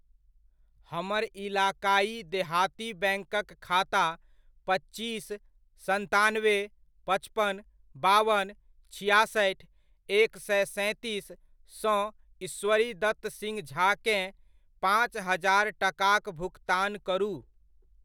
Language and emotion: Maithili, neutral